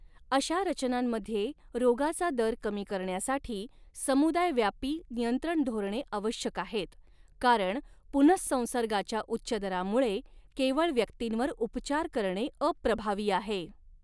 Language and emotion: Marathi, neutral